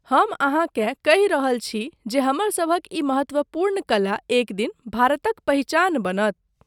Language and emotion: Maithili, neutral